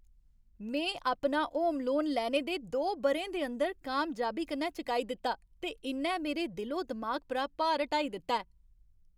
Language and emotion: Dogri, happy